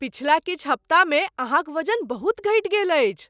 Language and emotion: Maithili, surprised